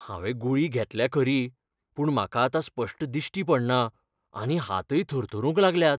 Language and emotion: Goan Konkani, fearful